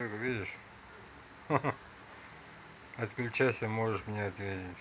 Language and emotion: Russian, neutral